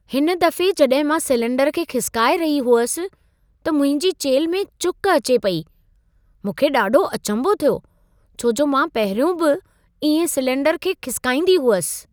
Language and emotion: Sindhi, surprised